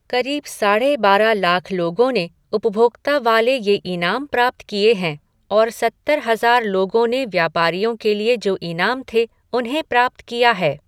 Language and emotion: Hindi, neutral